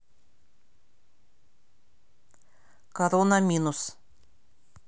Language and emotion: Russian, neutral